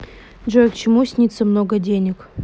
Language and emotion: Russian, neutral